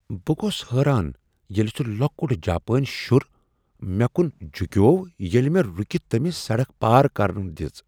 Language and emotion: Kashmiri, surprised